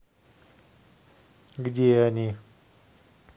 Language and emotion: Russian, neutral